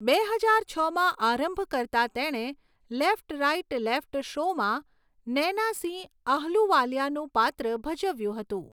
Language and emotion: Gujarati, neutral